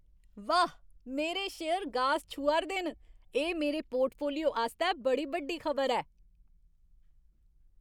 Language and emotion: Dogri, happy